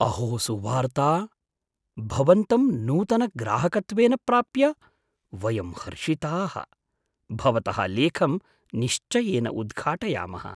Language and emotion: Sanskrit, surprised